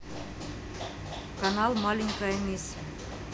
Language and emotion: Russian, neutral